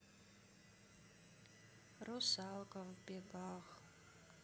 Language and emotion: Russian, sad